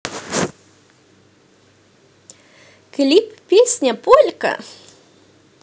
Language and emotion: Russian, positive